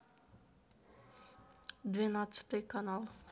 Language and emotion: Russian, neutral